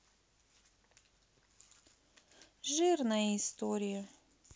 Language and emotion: Russian, sad